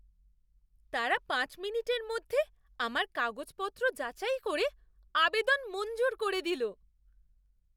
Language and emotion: Bengali, surprised